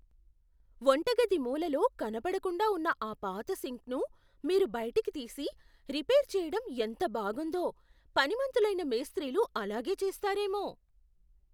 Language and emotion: Telugu, surprised